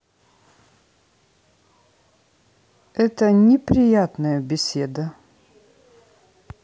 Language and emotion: Russian, neutral